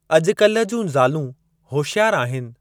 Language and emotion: Sindhi, neutral